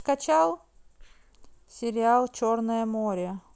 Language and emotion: Russian, neutral